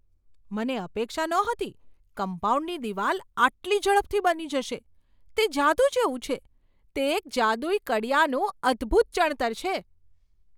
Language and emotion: Gujarati, surprised